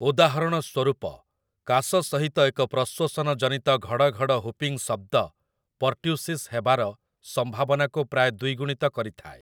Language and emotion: Odia, neutral